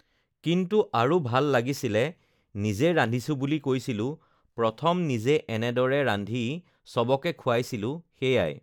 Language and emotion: Assamese, neutral